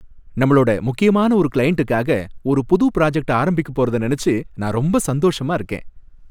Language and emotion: Tamil, happy